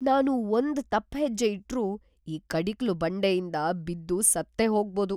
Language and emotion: Kannada, fearful